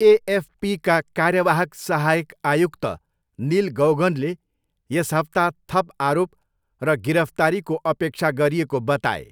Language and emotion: Nepali, neutral